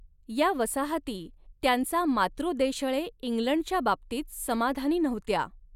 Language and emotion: Marathi, neutral